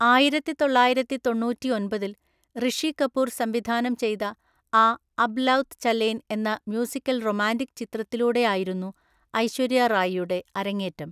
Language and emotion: Malayalam, neutral